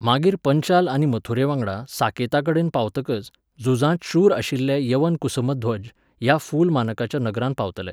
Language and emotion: Goan Konkani, neutral